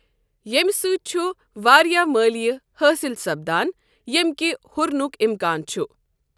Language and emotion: Kashmiri, neutral